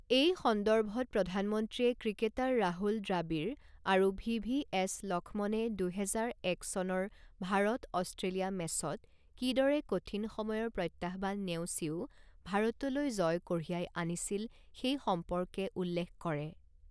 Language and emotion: Assamese, neutral